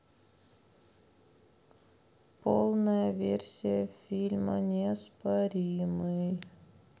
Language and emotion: Russian, sad